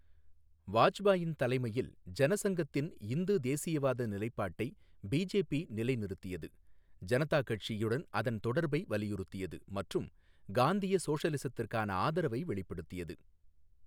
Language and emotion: Tamil, neutral